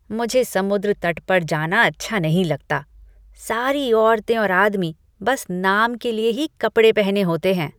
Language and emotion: Hindi, disgusted